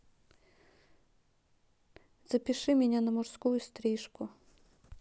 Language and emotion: Russian, neutral